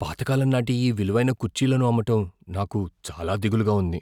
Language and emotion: Telugu, fearful